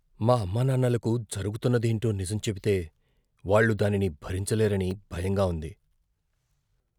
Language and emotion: Telugu, fearful